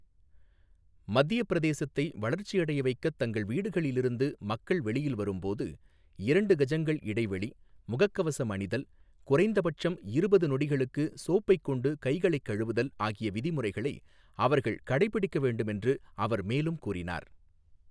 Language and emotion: Tamil, neutral